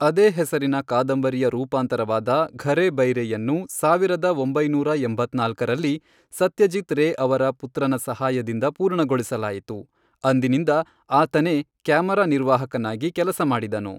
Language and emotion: Kannada, neutral